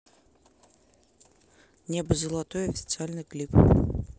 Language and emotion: Russian, neutral